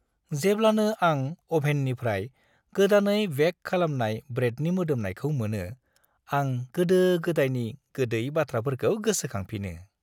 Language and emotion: Bodo, happy